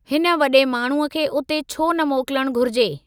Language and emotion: Sindhi, neutral